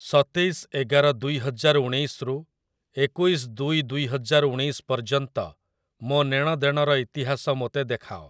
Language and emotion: Odia, neutral